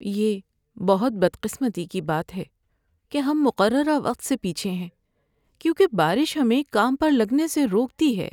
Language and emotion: Urdu, sad